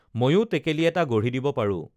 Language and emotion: Assamese, neutral